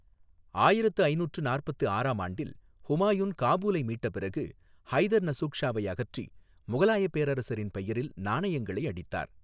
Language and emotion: Tamil, neutral